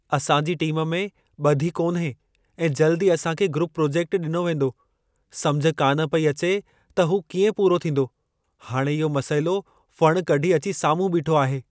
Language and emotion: Sindhi, fearful